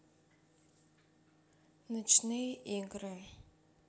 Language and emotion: Russian, neutral